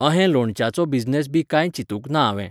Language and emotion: Goan Konkani, neutral